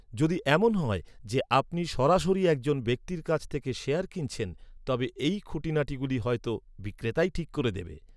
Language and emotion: Bengali, neutral